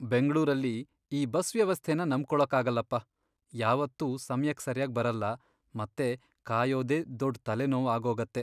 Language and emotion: Kannada, sad